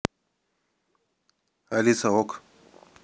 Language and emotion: Russian, neutral